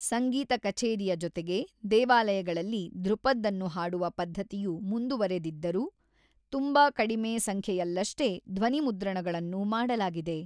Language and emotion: Kannada, neutral